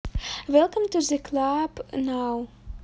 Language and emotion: Russian, positive